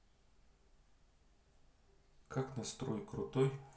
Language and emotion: Russian, neutral